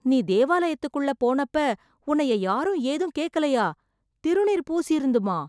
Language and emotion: Tamil, surprised